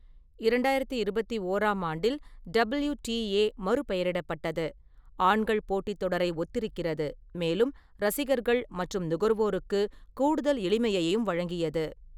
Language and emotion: Tamil, neutral